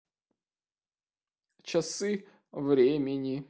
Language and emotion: Russian, sad